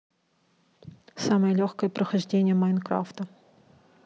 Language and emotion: Russian, neutral